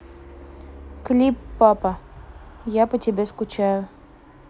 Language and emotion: Russian, neutral